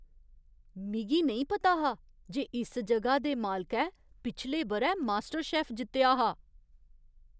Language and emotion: Dogri, surprised